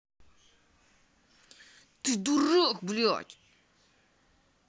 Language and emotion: Russian, angry